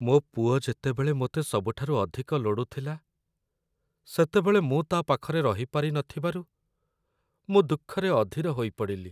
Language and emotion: Odia, sad